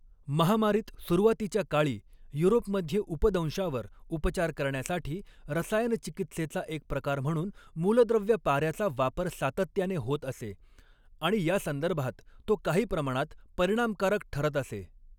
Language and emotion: Marathi, neutral